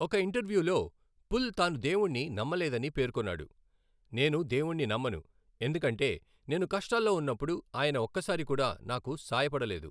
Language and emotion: Telugu, neutral